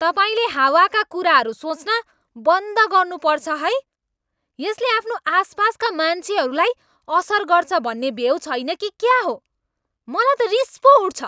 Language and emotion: Nepali, angry